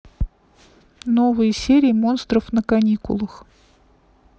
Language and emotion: Russian, neutral